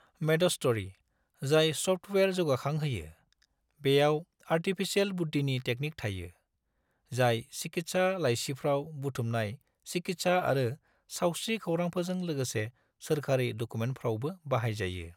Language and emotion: Bodo, neutral